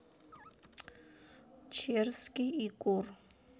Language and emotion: Russian, neutral